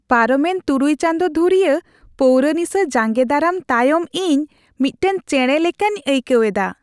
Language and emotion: Santali, happy